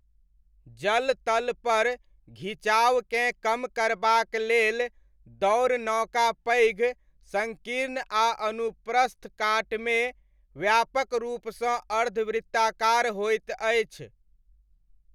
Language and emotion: Maithili, neutral